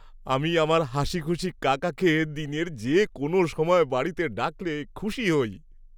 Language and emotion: Bengali, happy